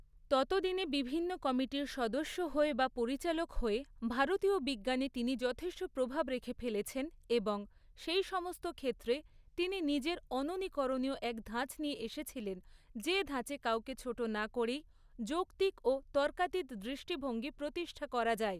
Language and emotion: Bengali, neutral